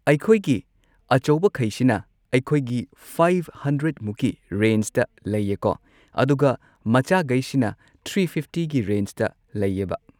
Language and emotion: Manipuri, neutral